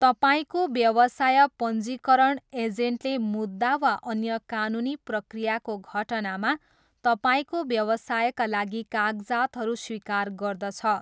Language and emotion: Nepali, neutral